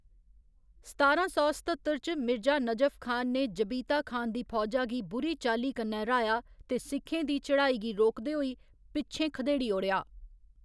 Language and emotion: Dogri, neutral